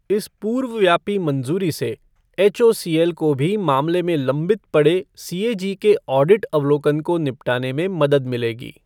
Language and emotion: Hindi, neutral